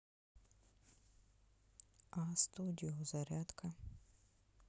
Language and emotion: Russian, neutral